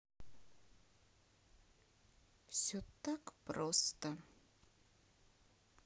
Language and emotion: Russian, sad